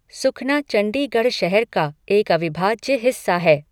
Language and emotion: Hindi, neutral